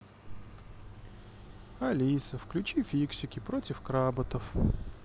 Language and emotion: Russian, sad